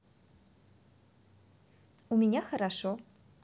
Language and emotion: Russian, positive